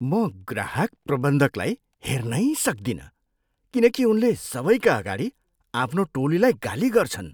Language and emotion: Nepali, disgusted